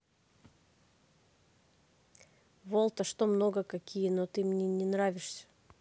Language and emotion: Russian, neutral